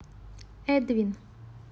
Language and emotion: Russian, neutral